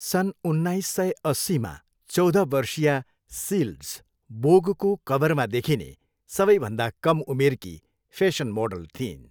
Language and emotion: Nepali, neutral